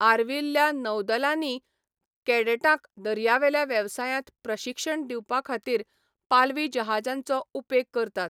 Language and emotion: Goan Konkani, neutral